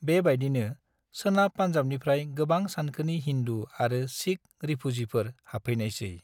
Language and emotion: Bodo, neutral